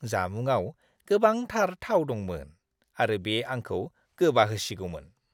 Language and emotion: Bodo, disgusted